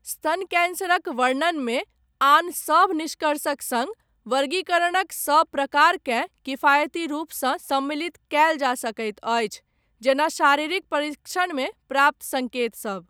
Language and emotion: Maithili, neutral